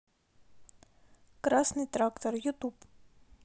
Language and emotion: Russian, neutral